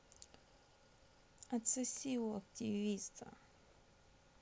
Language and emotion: Russian, neutral